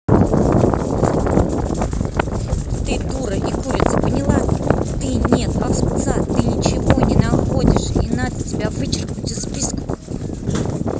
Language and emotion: Russian, angry